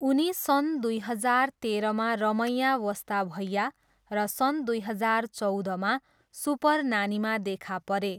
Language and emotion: Nepali, neutral